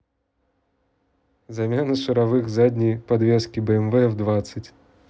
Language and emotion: Russian, neutral